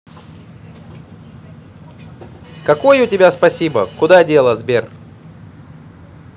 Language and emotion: Russian, positive